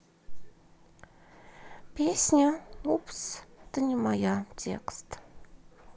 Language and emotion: Russian, sad